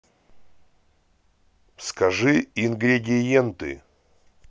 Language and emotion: Russian, neutral